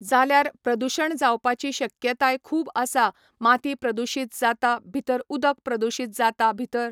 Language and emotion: Goan Konkani, neutral